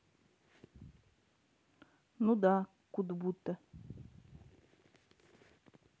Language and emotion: Russian, neutral